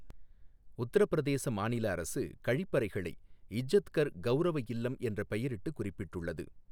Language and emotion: Tamil, neutral